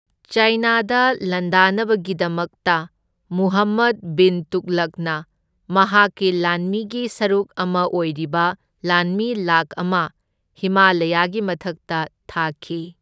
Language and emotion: Manipuri, neutral